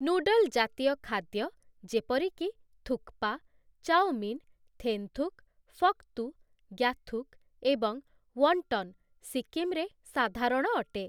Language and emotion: Odia, neutral